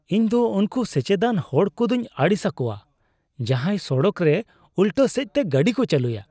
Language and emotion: Santali, disgusted